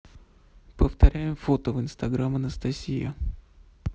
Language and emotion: Russian, neutral